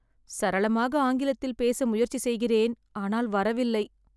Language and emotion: Tamil, sad